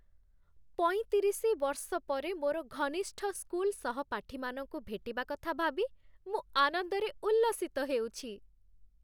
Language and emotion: Odia, happy